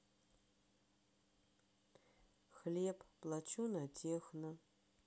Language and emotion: Russian, sad